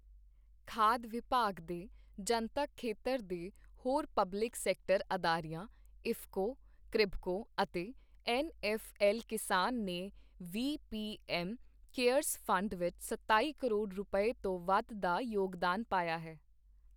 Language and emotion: Punjabi, neutral